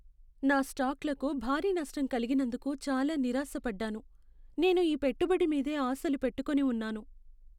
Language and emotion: Telugu, sad